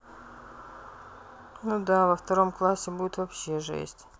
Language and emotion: Russian, sad